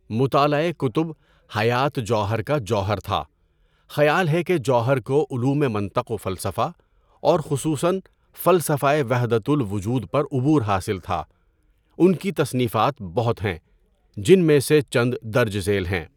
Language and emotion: Urdu, neutral